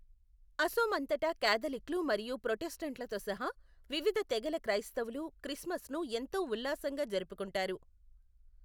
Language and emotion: Telugu, neutral